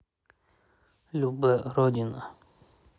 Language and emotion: Russian, neutral